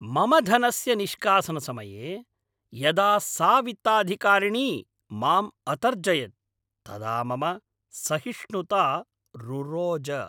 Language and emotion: Sanskrit, angry